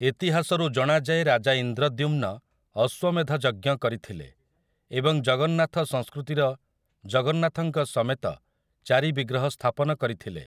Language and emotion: Odia, neutral